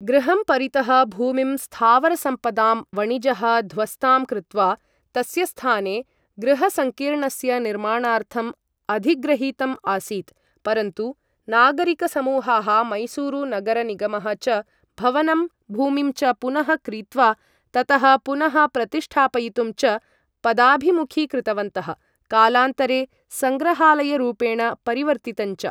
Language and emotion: Sanskrit, neutral